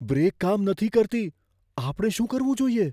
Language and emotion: Gujarati, fearful